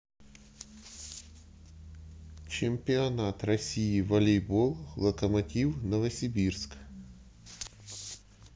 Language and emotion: Russian, neutral